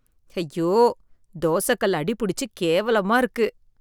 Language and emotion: Tamil, disgusted